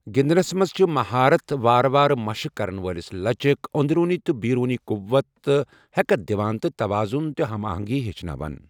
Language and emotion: Kashmiri, neutral